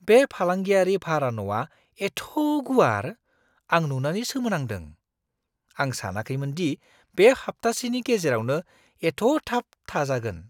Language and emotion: Bodo, surprised